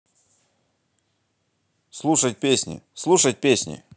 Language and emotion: Russian, positive